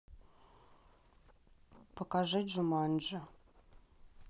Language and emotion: Russian, neutral